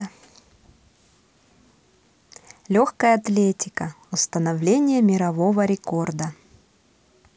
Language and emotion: Russian, positive